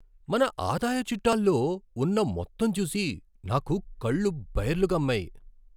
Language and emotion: Telugu, surprised